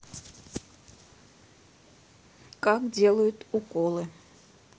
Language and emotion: Russian, neutral